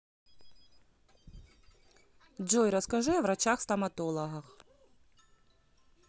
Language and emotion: Russian, neutral